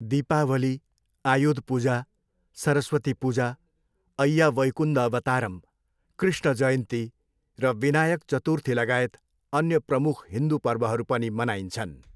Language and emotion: Nepali, neutral